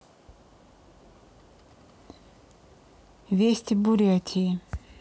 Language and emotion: Russian, neutral